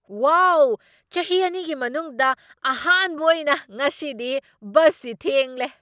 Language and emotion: Manipuri, surprised